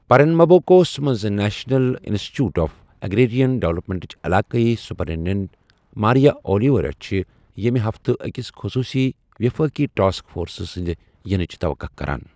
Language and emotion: Kashmiri, neutral